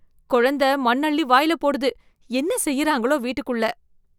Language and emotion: Tamil, disgusted